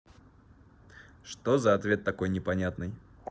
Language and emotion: Russian, neutral